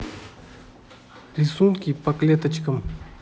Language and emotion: Russian, neutral